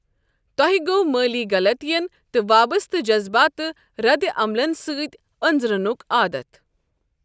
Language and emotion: Kashmiri, neutral